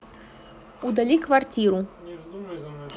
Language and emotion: Russian, neutral